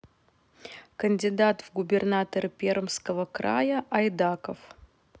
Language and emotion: Russian, neutral